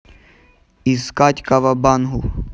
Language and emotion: Russian, neutral